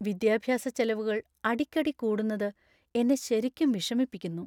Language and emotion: Malayalam, sad